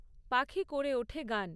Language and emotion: Bengali, neutral